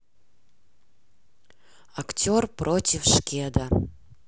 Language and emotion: Russian, neutral